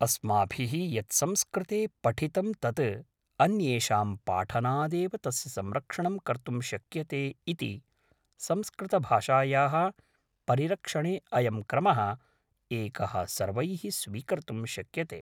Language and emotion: Sanskrit, neutral